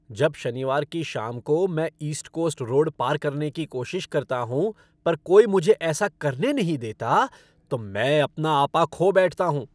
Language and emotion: Hindi, angry